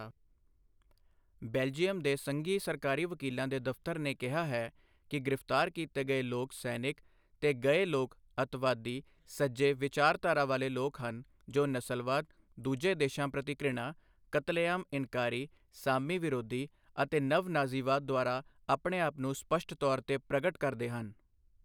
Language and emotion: Punjabi, neutral